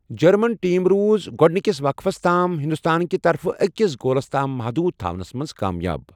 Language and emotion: Kashmiri, neutral